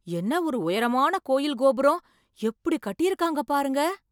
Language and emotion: Tamil, surprised